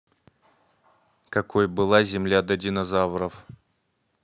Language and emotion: Russian, neutral